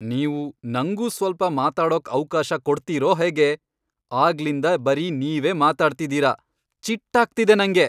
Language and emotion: Kannada, angry